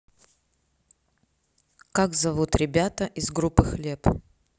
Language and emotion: Russian, neutral